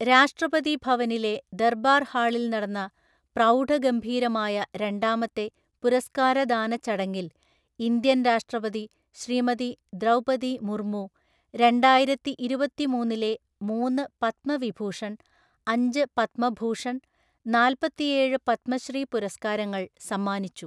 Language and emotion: Malayalam, neutral